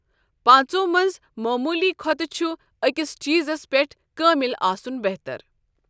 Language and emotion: Kashmiri, neutral